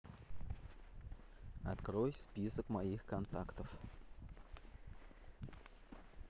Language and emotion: Russian, neutral